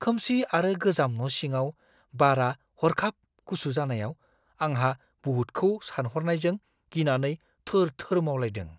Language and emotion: Bodo, fearful